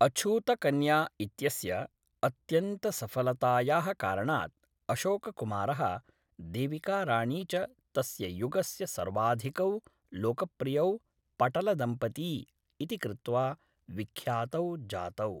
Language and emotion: Sanskrit, neutral